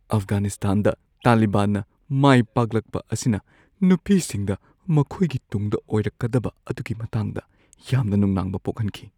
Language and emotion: Manipuri, fearful